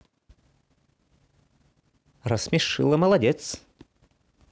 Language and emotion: Russian, positive